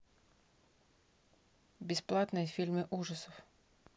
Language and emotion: Russian, neutral